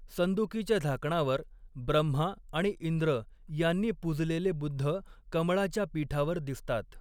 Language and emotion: Marathi, neutral